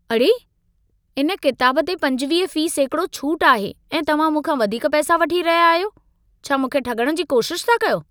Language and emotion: Sindhi, angry